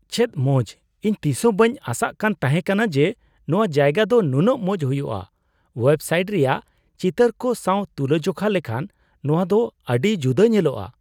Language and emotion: Santali, surprised